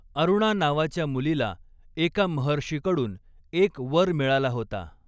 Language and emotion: Marathi, neutral